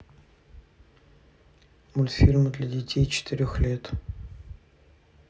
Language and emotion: Russian, neutral